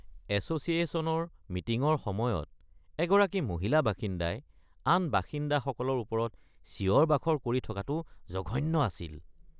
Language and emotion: Assamese, disgusted